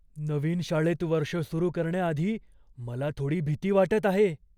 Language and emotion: Marathi, fearful